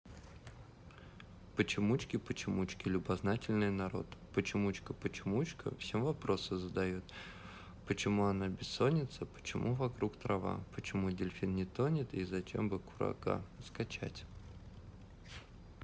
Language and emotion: Russian, neutral